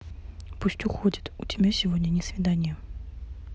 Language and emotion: Russian, neutral